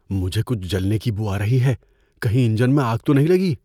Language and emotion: Urdu, fearful